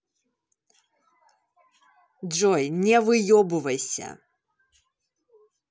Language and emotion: Russian, angry